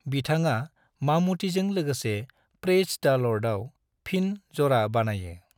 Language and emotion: Bodo, neutral